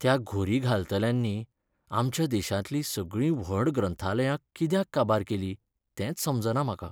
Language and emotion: Goan Konkani, sad